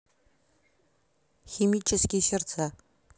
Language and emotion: Russian, neutral